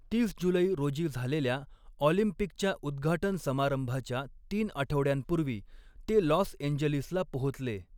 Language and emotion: Marathi, neutral